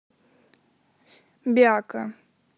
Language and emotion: Russian, neutral